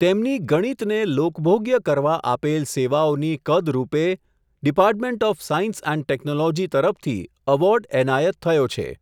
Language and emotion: Gujarati, neutral